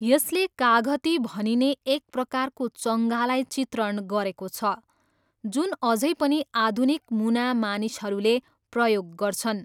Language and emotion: Nepali, neutral